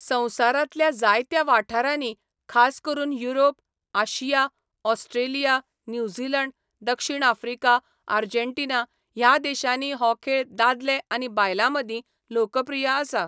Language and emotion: Goan Konkani, neutral